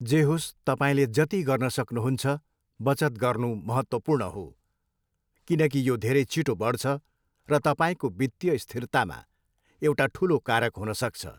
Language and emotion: Nepali, neutral